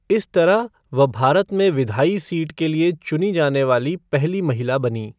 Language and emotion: Hindi, neutral